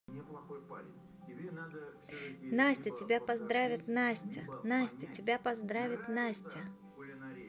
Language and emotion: Russian, positive